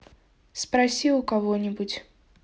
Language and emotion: Russian, neutral